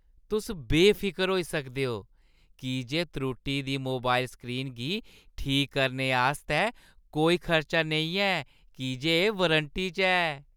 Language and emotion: Dogri, happy